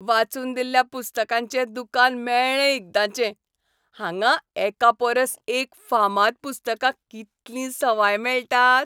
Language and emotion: Goan Konkani, happy